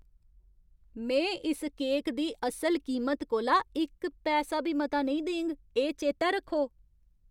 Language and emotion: Dogri, angry